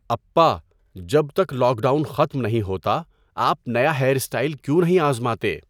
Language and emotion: Urdu, neutral